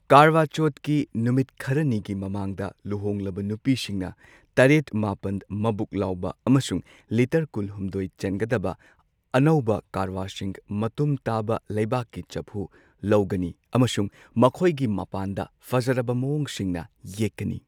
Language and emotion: Manipuri, neutral